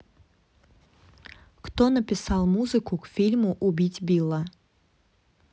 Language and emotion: Russian, neutral